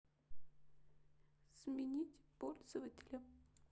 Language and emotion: Russian, sad